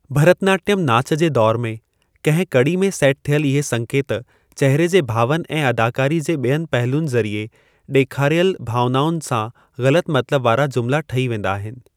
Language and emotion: Sindhi, neutral